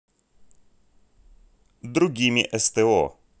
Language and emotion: Russian, neutral